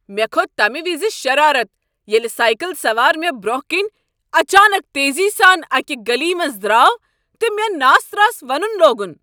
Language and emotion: Kashmiri, angry